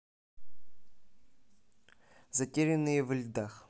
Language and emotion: Russian, neutral